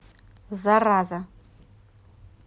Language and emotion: Russian, angry